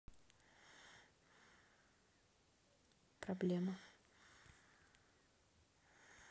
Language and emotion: Russian, sad